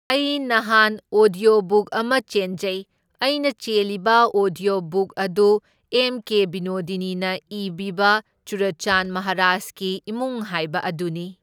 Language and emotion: Manipuri, neutral